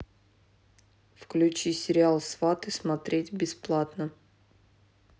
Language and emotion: Russian, neutral